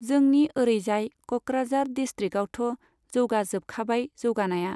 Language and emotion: Bodo, neutral